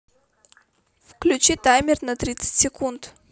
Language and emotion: Russian, neutral